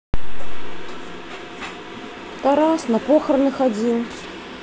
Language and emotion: Russian, neutral